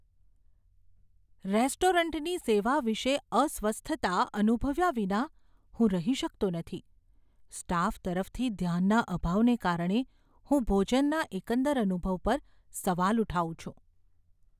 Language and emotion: Gujarati, fearful